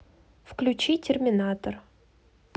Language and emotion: Russian, neutral